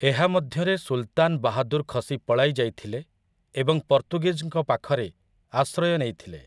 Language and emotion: Odia, neutral